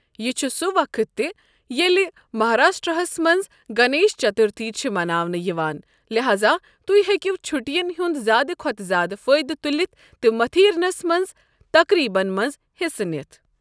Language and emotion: Kashmiri, neutral